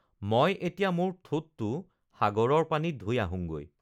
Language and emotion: Assamese, neutral